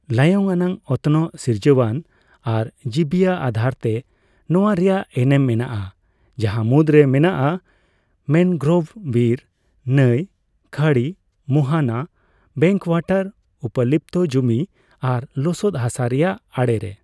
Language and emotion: Santali, neutral